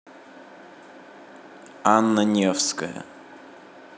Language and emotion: Russian, neutral